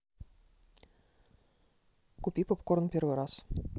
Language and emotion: Russian, neutral